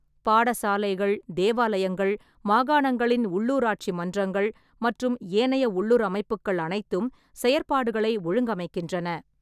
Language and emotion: Tamil, neutral